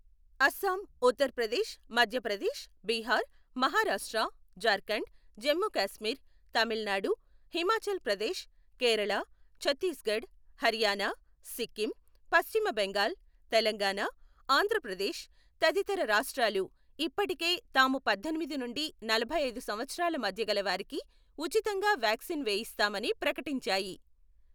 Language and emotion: Telugu, neutral